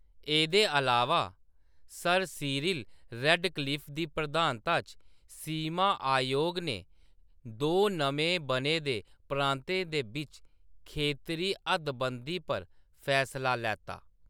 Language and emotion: Dogri, neutral